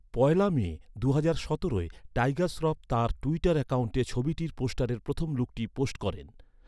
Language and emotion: Bengali, neutral